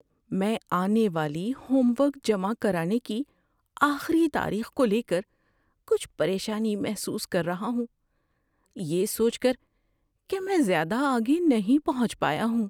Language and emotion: Urdu, fearful